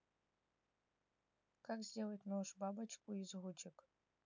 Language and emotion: Russian, neutral